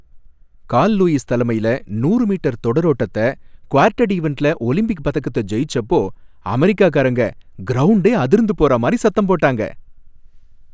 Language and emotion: Tamil, happy